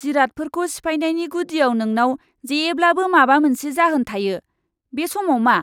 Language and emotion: Bodo, disgusted